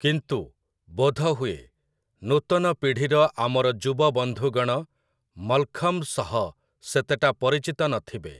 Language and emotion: Odia, neutral